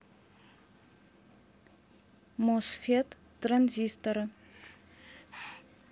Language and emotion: Russian, neutral